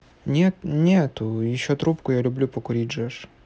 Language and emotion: Russian, neutral